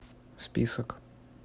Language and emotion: Russian, neutral